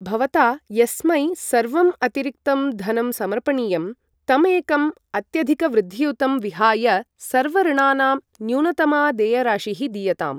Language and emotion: Sanskrit, neutral